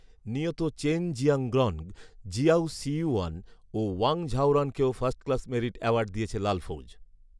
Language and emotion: Bengali, neutral